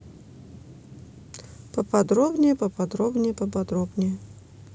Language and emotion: Russian, neutral